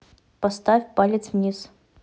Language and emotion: Russian, neutral